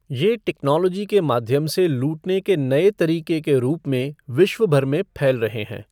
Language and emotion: Hindi, neutral